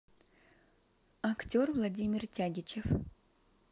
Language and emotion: Russian, neutral